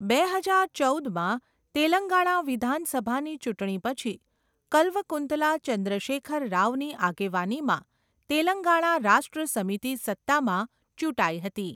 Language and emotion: Gujarati, neutral